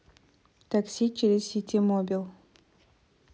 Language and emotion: Russian, neutral